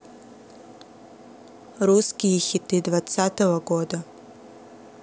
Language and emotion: Russian, neutral